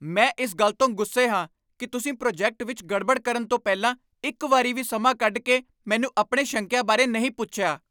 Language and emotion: Punjabi, angry